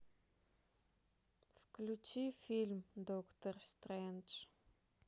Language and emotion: Russian, sad